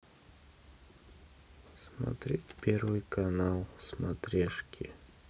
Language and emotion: Russian, sad